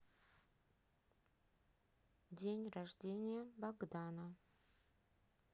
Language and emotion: Russian, neutral